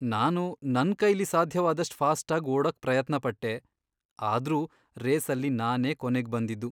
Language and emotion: Kannada, sad